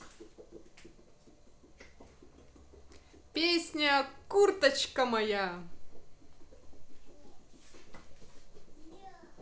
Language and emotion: Russian, positive